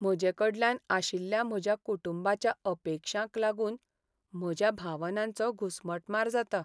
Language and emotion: Goan Konkani, sad